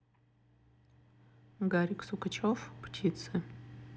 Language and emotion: Russian, neutral